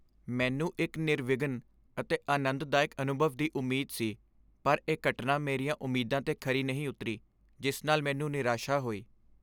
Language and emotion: Punjabi, sad